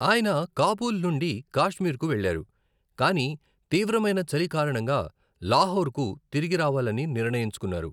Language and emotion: Telugu, neutral